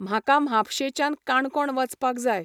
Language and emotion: Goan Konkani, neutral